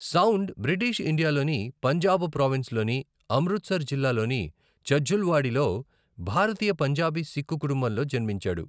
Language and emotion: Telugu, neutral